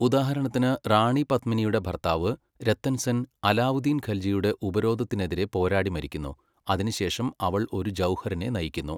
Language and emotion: Malayalam, neutral